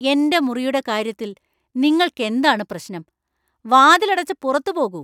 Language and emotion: Malayalam, angry